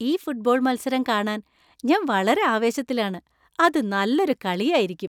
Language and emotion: Malayalam, happy